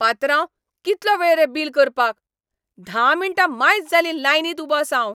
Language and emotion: Goan Konkani, angry